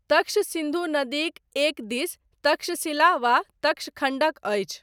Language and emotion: Maithili, neutral